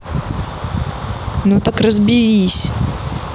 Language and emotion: Russian, angry